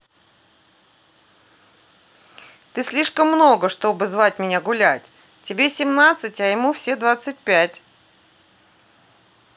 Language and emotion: Russian, neutral